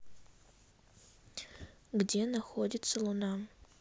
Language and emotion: Russian, neutral